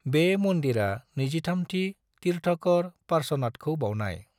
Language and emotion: Bodo, neutral